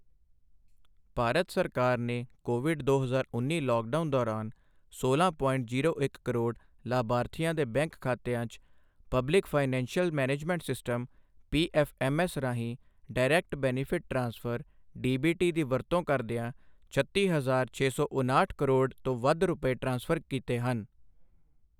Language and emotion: Punjabi, neutral